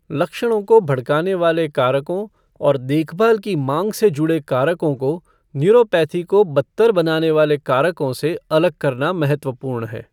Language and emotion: Hindi, neutral